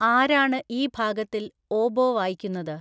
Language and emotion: Malayalam, neutral